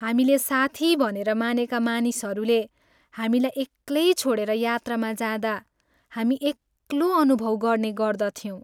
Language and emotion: Nepali, sad